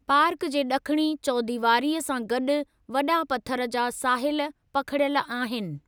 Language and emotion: Sindhi, neutral